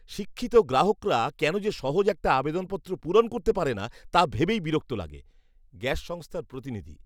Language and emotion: Bengali, disgusted